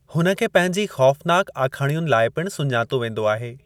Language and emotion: Sindhi, neutral